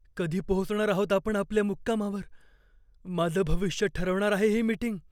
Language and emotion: Marathi, fearful